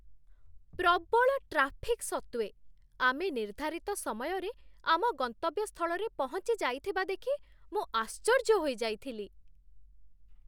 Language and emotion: Odia, surprised